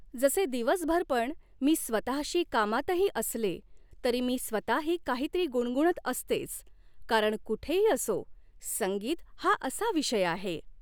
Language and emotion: Marathi, neutral